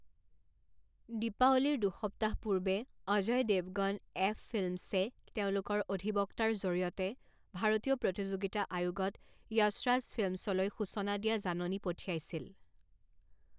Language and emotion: Assamese, neutral